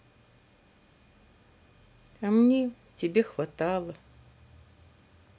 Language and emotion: Russian, sad